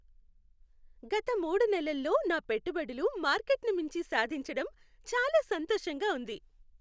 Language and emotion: Telugu, happy